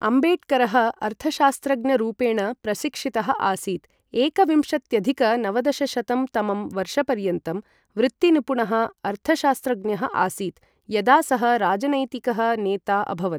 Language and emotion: Sanskrit, neutral